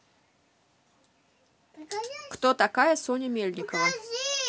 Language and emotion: Russian, positive